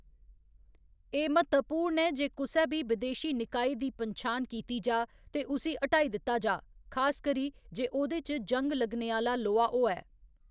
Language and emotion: Dogri, neutral